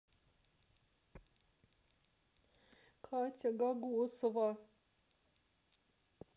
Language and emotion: Russian, sad